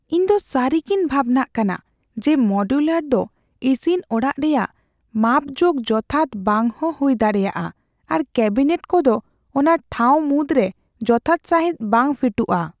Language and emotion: Santali, fearful